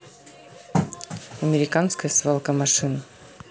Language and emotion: Russian, neutral